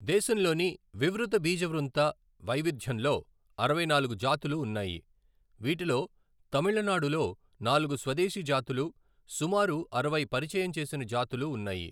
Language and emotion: Telugu, neutral